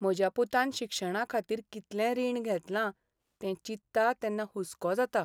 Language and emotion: Goan Konkani, sad